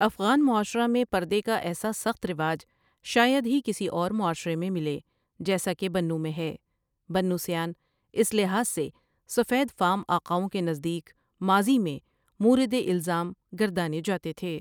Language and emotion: Urdu, neutral